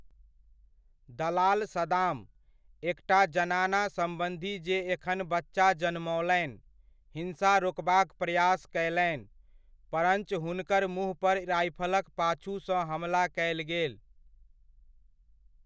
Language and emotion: Maithili, neutral